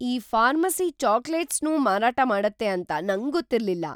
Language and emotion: Kannada, surprised